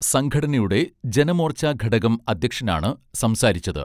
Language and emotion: Malayalam, neutral